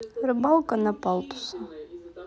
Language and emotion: Russian, neutral